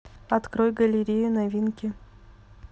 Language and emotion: Russian, neutral